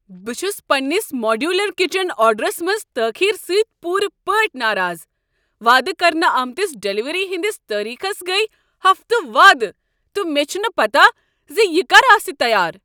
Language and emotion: Kashmiri, angry